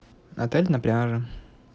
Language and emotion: Russian, neutral